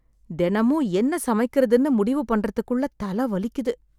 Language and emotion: Tamil, sad